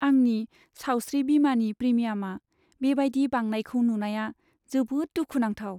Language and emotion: Bodo, sad